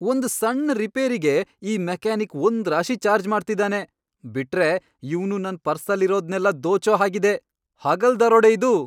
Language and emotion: Kannada, angry